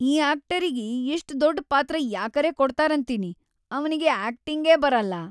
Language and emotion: Kannada, disgusted